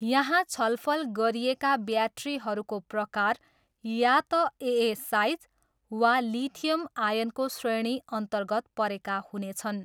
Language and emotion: Nepali, neutral